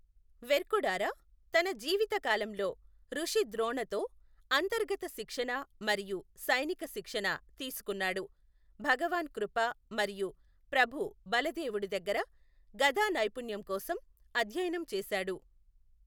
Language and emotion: Telugu, neutral